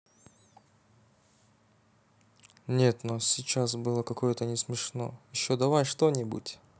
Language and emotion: Russian, neutral